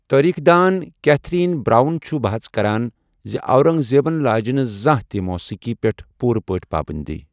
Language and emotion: Kashmiri, neutral